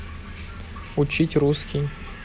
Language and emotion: Russian, neutral